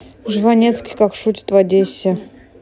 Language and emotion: Russian, neutral